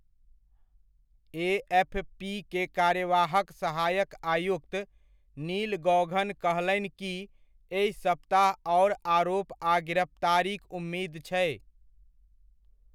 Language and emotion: Maithili, neutral